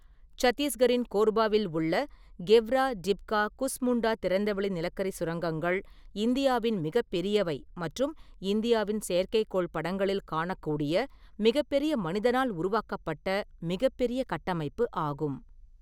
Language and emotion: Tamil, neutral